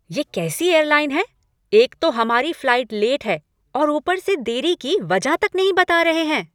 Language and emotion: Hindi, angry